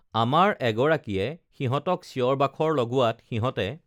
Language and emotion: Assamese, neutral